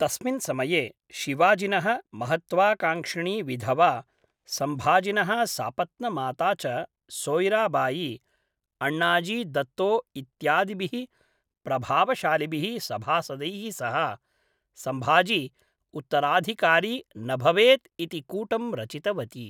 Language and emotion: Sanskrit, neutral